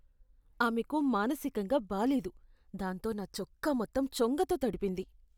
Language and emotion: Telugu, disgusted